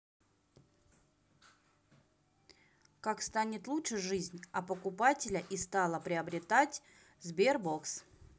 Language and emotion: Russian, neutral